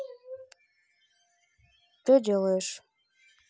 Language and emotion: Russian, neutral